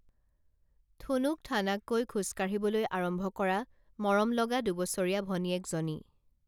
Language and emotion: Assamese, neutral